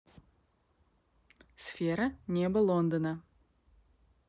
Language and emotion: Russian, neutral